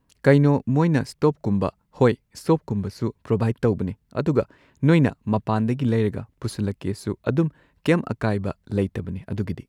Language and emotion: Manipuri, neutral